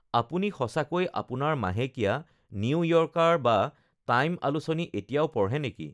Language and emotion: Assamese, neutral